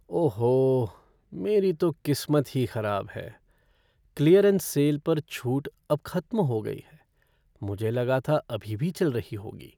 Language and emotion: Hindi, sad